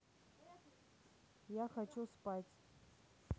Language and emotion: Russian, neutral